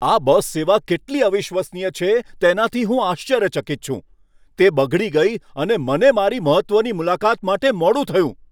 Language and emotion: Gujarati, angry